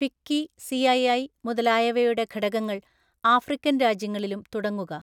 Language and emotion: Malayalam, neutral